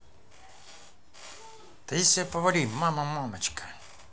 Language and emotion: Russian, neutral